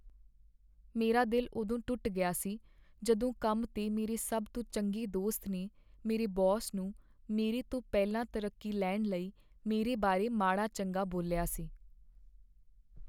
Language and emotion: Punjabi, sad